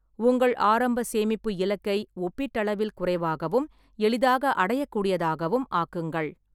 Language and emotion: Tamil, neutral